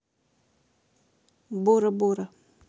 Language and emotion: Russian, neutral